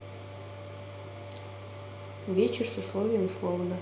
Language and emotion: Russian, neutral